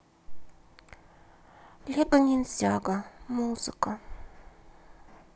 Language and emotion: Russian, sad